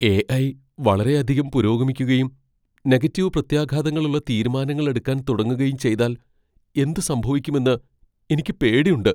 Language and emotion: Malayalam, fearful